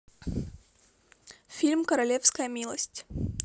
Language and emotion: Russian, neutral